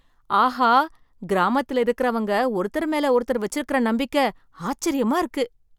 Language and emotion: Tamil, surprised